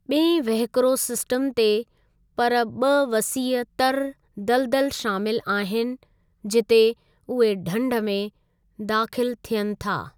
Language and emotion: Sindhi, neutral